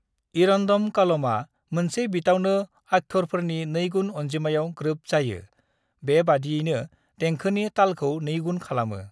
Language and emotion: Bodo, neutral